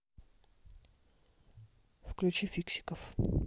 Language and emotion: Russian, neutral